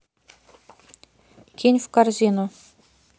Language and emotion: Russian, neutral